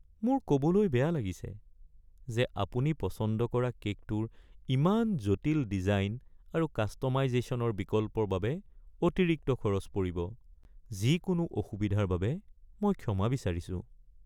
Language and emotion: Assamese, sad